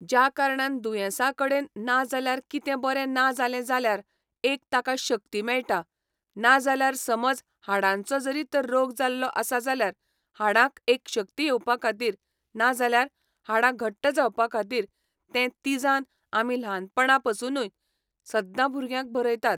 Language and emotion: Goan Konkani, neutral